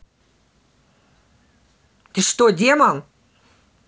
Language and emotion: Russian, angry